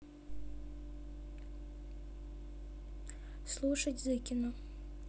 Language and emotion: Russian, neutral